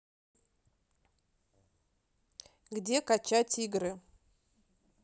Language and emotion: Russian, neutral